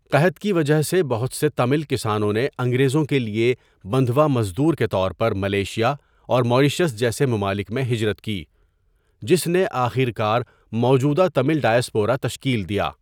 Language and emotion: Urdu, neutral